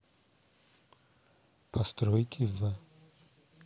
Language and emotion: Russian, neutral